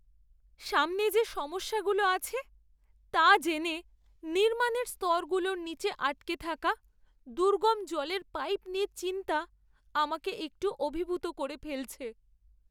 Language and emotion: Bengali, sad